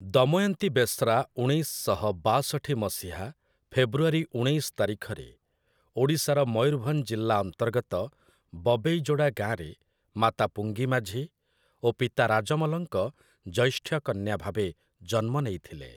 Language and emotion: Odia, neutral